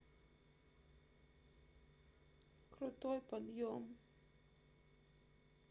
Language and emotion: Russian, sad